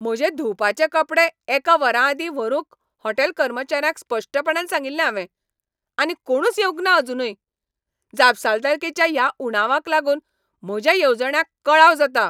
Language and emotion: Goan Konkani, angry